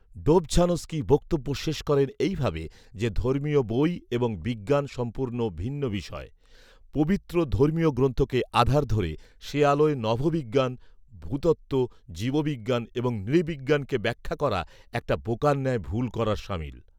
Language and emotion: Bengali, neutral